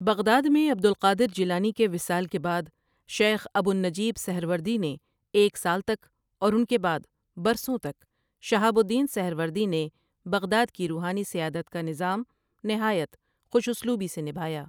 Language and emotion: Urdu, neutral